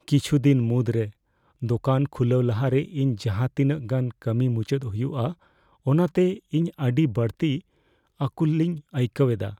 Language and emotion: Santali, fearful